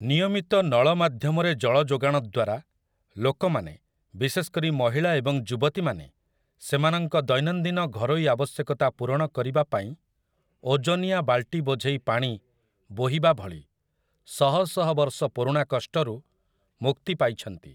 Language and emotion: Odia, neutral